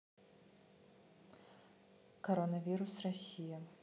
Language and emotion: Russian, neutral